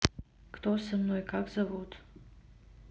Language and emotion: Russian, neutral